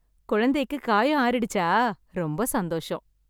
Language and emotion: Tamil, happy